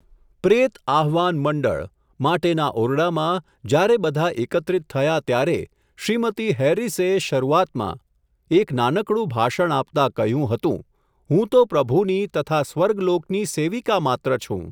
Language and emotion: Gujarati, neutral